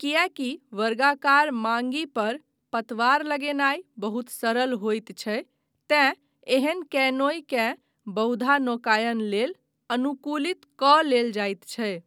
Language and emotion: Maithili, neutral